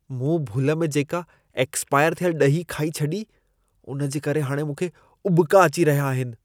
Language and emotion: Sindhi, disgusted